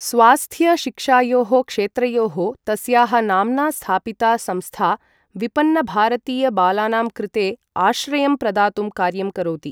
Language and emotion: Sanskrit, neutral